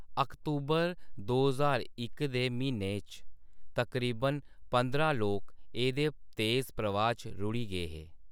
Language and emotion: Dogri, neutral